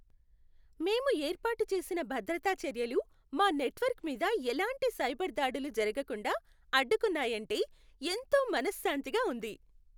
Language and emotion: Telugu, happy